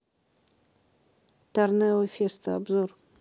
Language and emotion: Russian, neutral